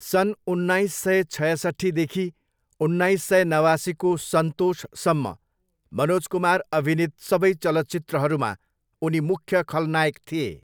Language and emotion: Nepali, neutral